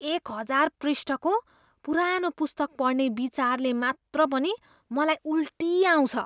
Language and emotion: Nepali, disgusted